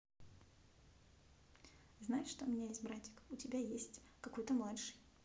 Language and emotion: Russian, neutral